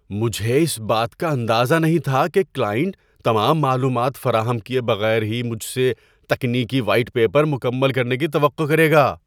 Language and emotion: Urdu, surprised